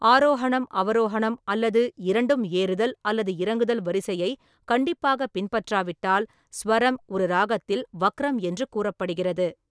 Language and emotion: Tamil, neutral